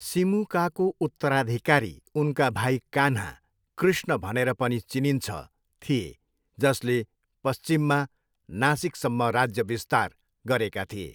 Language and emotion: Nepali, neutral